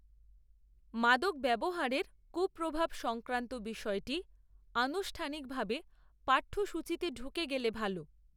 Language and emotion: Bengali, neutral